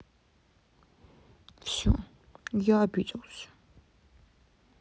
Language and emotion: Russian, sad